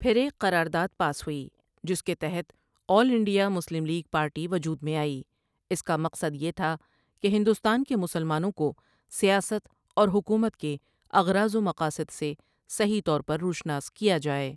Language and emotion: Urdu, neutral